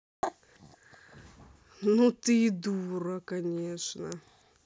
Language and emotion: Russian, angry